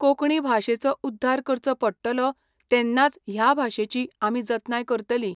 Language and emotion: Goan Konkani, neutral